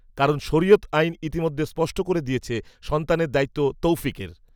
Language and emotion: Bengali, neutral